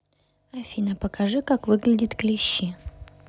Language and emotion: Russian, neutral